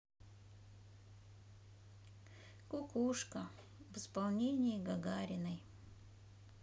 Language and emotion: Russian, sad